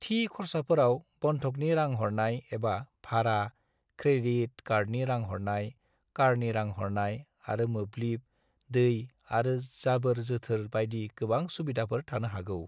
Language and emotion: Bodo, neutral